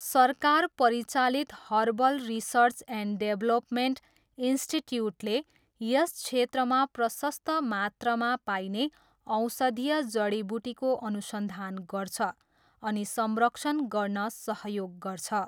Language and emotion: Nepali, neutral